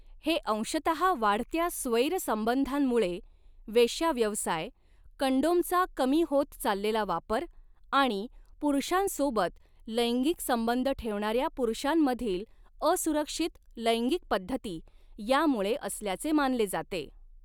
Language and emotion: Marathi, neutral